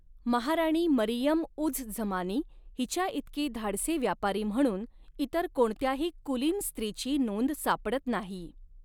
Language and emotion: Marathi, neutral